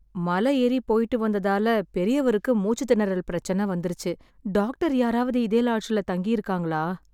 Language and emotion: Tamil, sad